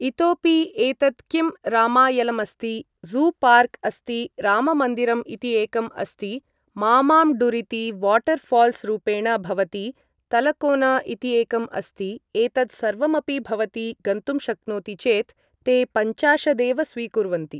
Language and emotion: Sanskrit, neutral